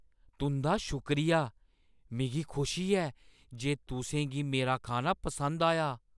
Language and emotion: Dogri, surprised